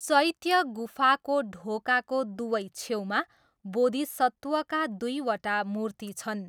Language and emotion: Nepali, neutral